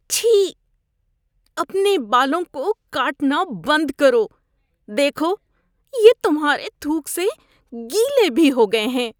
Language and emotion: Urdu, disgusted